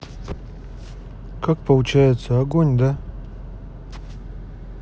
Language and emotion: Russian, neutral